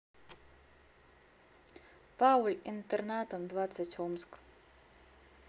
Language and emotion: Russian, neutral